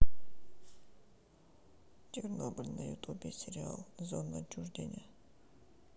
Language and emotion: Russian, sad